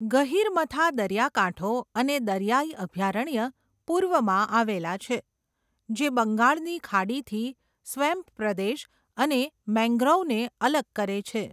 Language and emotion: Gujarati, neutral